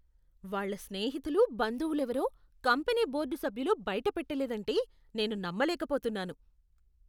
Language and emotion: Telugu, disgusted